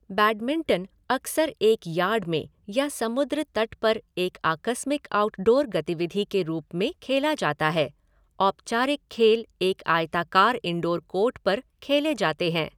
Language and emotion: Hindi, neutral